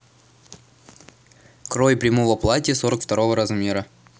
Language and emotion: Russian, neutral